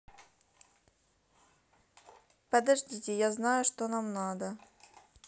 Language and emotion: Russian, neutral